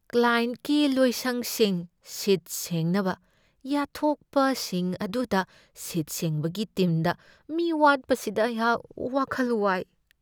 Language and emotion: Manipuri, fearful